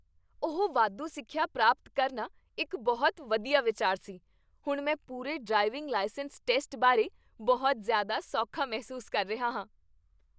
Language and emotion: Punjabi, happy